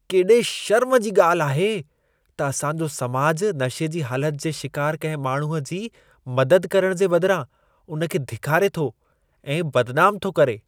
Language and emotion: Sindhi, disgusted